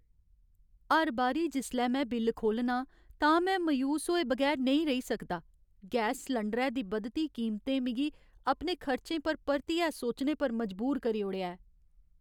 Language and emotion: Dogri, sad